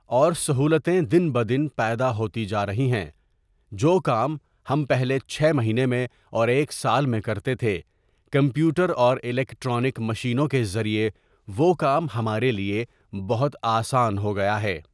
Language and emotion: Urdu, neutral